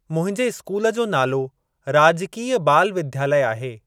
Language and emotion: Sindhi, neutral